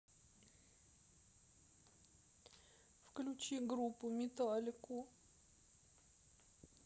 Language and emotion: Russian, sad